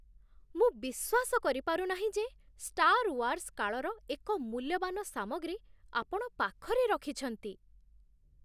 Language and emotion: Odia, surprised